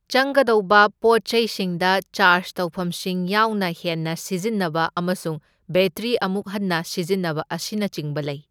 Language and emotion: Manipuri, neutral